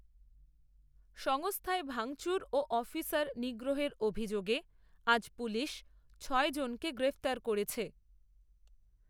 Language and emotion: Bengali, neutral